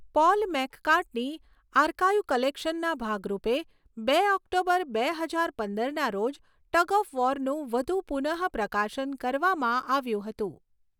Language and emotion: Gujarati, neutral